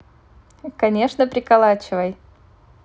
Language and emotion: Russian, neutral